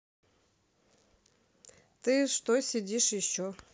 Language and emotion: Russian, neutral